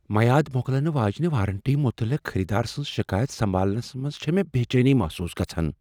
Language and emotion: Kashmiri, fearful